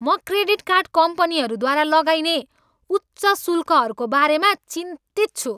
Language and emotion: Nepali, angry